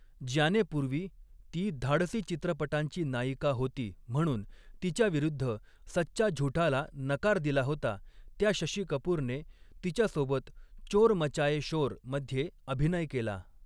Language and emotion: Marathi, neutral